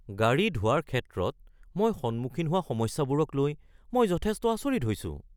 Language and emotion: Assamese, surprised